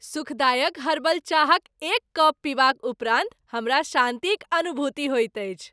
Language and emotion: Maithili, happy